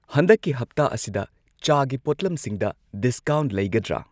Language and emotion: Manipuri, neutral